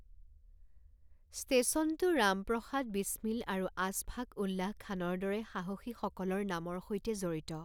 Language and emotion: Assamese, neutral